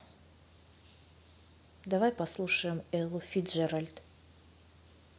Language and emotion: Russian, neutral